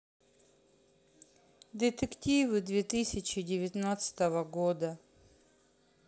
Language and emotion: Russian, sad